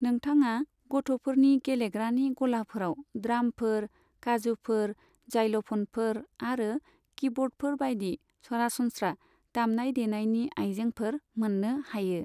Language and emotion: Bodo, neutral